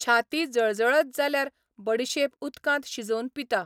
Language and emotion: Goan Konkani, neutral